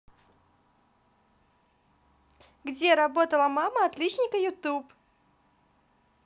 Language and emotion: Russian, positive